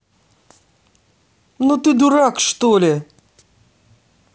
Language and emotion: Russian, angry